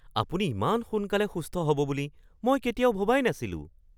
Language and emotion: Assamese, surprised